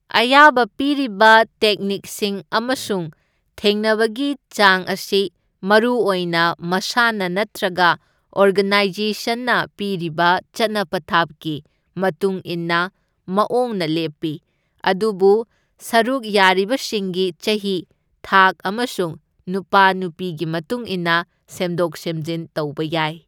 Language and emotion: Manipuri, neutral